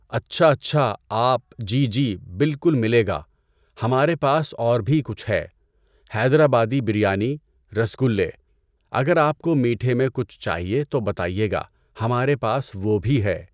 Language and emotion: Urdu, neutral